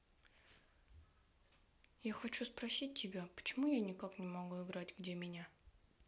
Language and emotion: Russian, sad